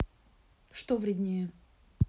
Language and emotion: Russian, neutral